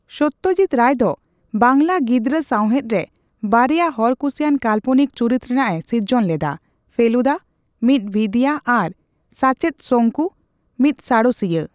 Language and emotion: Santali, neutral